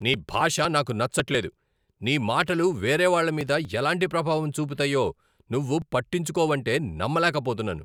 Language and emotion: Telugu, angry